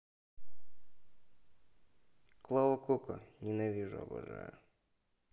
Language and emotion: Russian, neutral